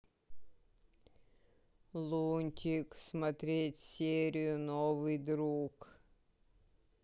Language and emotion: Russian, sad